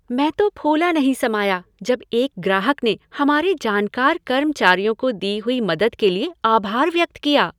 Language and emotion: Hindi, happy